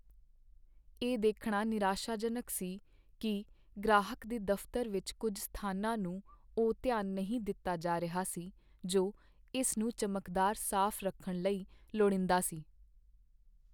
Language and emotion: Punjabi, sad